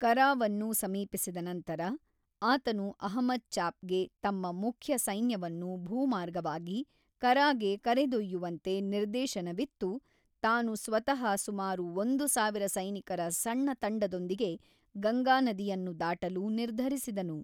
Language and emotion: Kannada, neutral